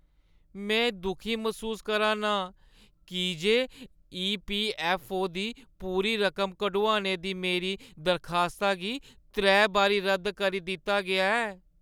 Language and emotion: Dogri, sad